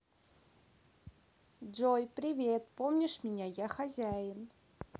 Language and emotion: Russian, neutral